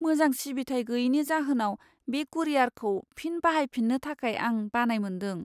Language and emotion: Bodo, fearful